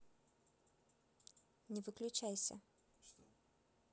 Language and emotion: Russian, neutral